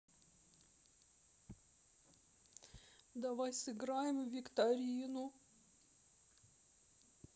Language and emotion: Russian, sad